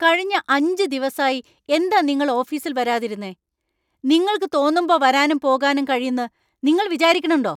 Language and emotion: Malayalam, angry